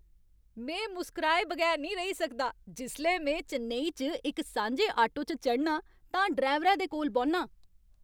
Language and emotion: Dogri, happy